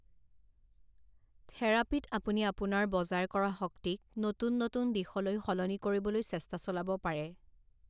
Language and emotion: Assamese, neutral